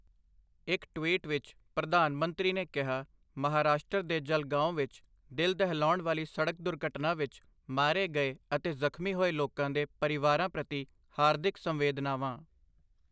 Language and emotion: Punjabi, neutral